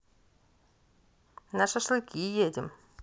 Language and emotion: Russian, neutral